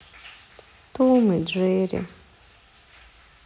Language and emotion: Russian, sad